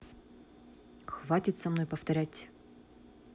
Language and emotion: Russian, angry